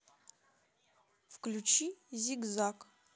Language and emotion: Russian, neutral